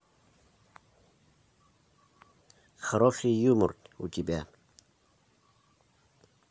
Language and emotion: Russian, neutral